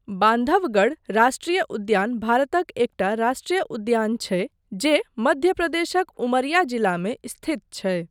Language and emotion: Maithili, neutral